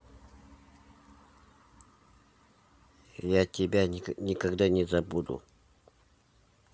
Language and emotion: Russian, neutral